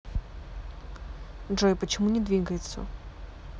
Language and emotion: Russian, neutral